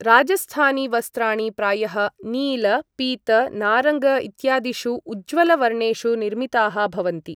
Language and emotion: Sanskrit, neutral